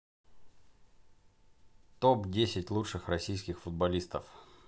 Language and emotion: Russian, neutral